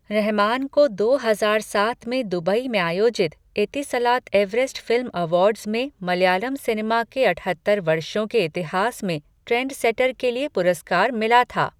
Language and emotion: Hindi, neutral